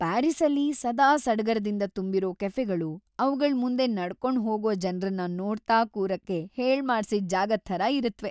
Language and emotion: Kannada, happy